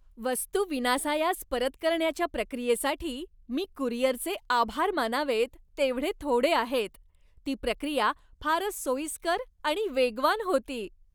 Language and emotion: Marathi, happy